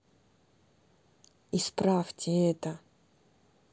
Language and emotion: Russian, neutral